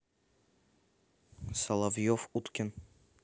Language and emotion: Russian, neutral